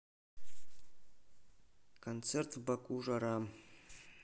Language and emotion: Russian, neutral